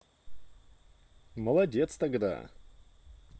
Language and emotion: Russian, positive